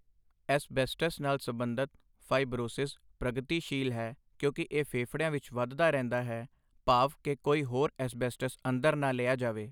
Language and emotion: Punjabi, neutral